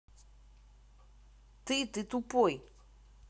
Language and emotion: Russian, angry